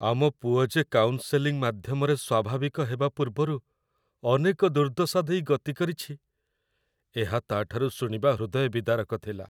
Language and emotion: Odia, sad